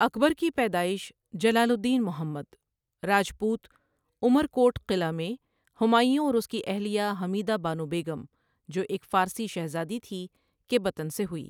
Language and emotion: Urdu, neutral